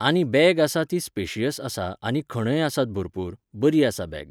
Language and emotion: Goan Konkani, neutral